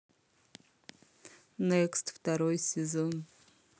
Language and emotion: Russian, positive